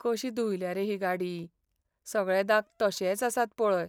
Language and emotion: Goan Konkani, sad